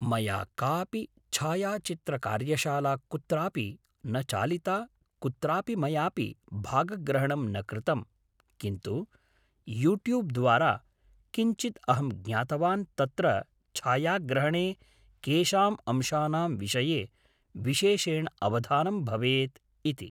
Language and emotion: Sanskrit, neutral